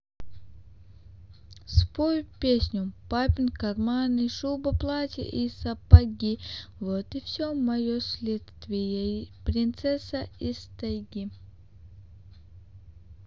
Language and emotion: Russian, neutral